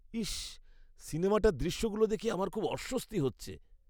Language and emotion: Bengali, disgusted